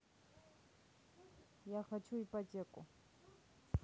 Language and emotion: Russian, neutral